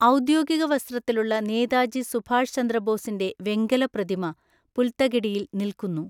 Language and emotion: Malayalam, neutral